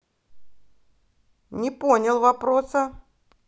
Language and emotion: Russian, angry